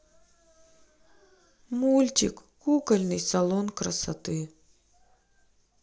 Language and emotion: Russian, sad